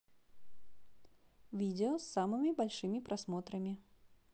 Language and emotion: Russian, positive